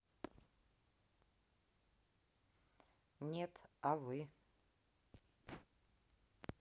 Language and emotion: Russian, neutral